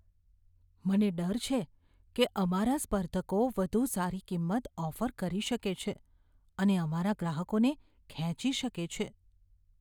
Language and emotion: Gujarati, fearful